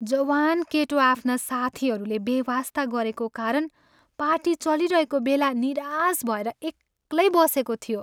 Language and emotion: Nepali, sad